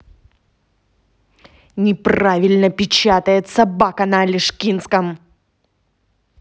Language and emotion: Russian, angry